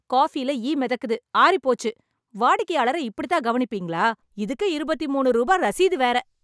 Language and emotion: Tamil, angry